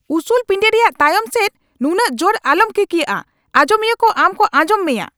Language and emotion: Santali, angry